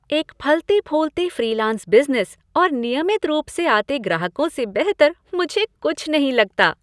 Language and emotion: Hindi, happy